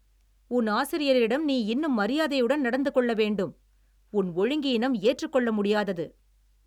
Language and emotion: Tamil, angry